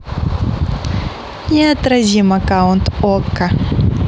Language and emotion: Russian, positive